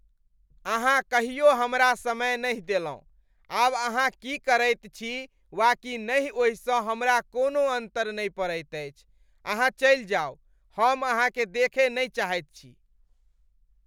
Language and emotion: Maithili, disgusted